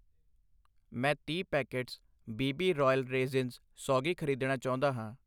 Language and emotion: Punjabi, neutral